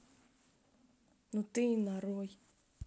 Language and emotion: Russian, neutral